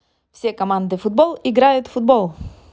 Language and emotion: Russian, positive